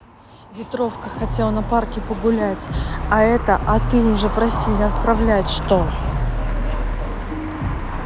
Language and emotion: Russian, neutral